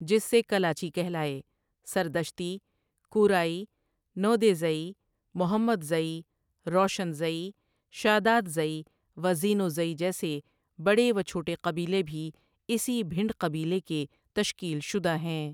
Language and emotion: Urdu, neutral